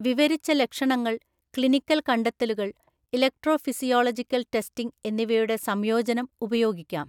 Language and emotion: Malayalam, neutral